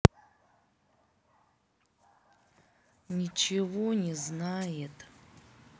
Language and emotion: Russian, angry